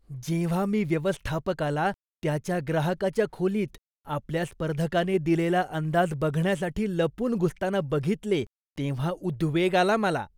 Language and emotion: Marathi, disgusted